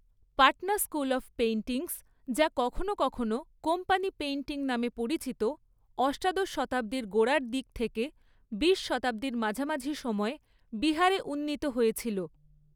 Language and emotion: Bengali, neutral